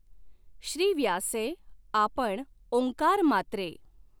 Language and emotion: Marathi, neutral